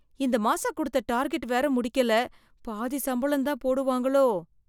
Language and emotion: Tamil, fearful